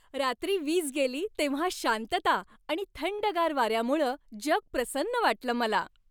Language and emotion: Marathi, happy